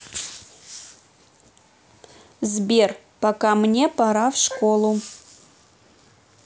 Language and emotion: Russian, neutral